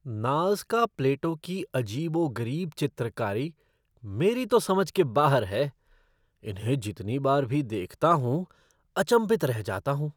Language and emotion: Hindi, surprised